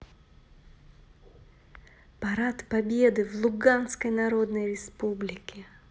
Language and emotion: Russian, positive